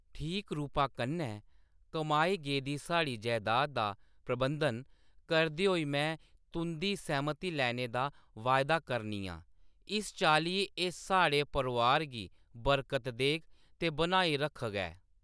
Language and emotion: Dogri, neutral